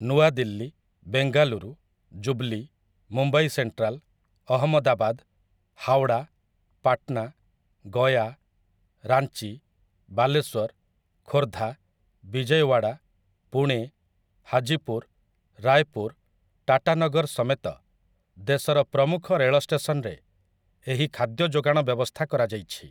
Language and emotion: Odia, neutral